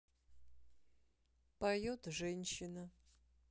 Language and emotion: Russian, neutral